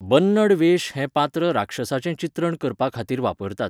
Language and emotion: Goan Konkani, neutral